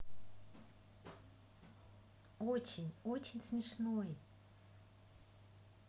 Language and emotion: Russian, positive